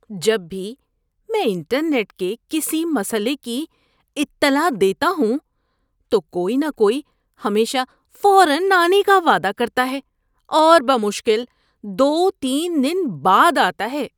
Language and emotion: Urdu, disgusted